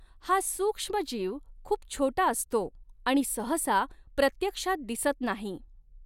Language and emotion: Marathi, neutral